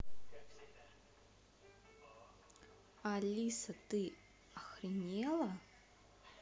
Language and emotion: Russian, angry